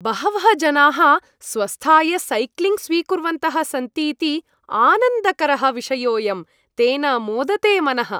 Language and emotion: Sanskrit, happy